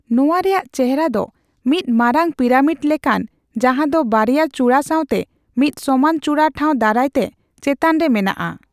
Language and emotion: Santali, neutral